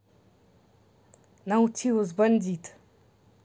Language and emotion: Russian, neutral